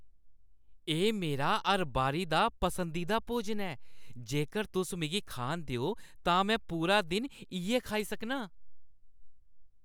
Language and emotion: Dogri, happy